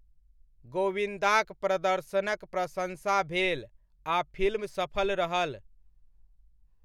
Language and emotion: Maithili, neutral